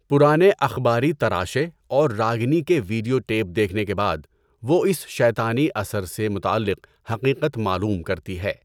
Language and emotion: Urdu, neutral